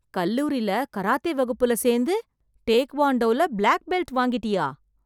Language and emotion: Tamil, surprised